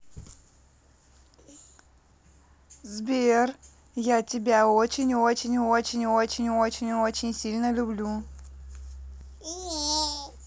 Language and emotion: Russian, positive